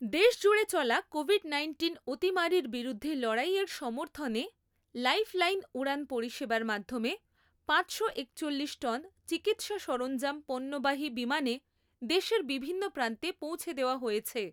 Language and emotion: Bengali, neutral